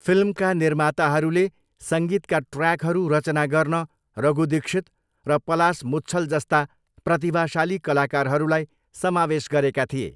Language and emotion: Nepali, neutral